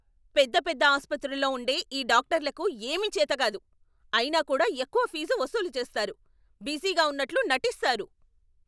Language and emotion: Telugu, angry